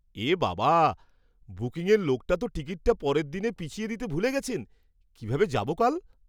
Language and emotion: Bengali, surprised